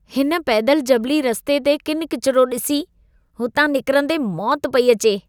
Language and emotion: Sindhi, disgusted